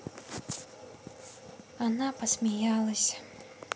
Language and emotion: Russian, sad